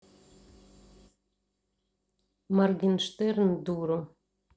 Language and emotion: Russian, neutral